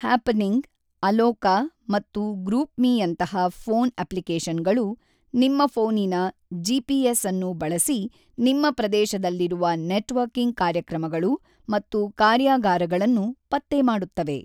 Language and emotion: Kannada, neutral